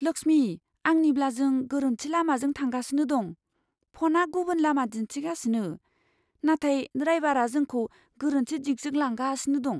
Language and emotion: Bodo, fearful